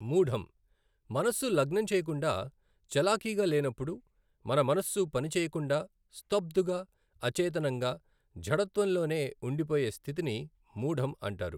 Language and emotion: Telugu, neutral